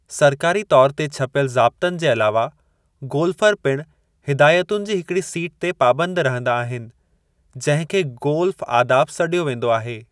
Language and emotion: Sindhi, neutral